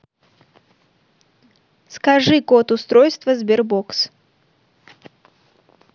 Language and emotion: Russian, neutral